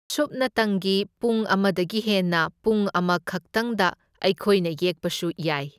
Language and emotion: Manipuri, neutral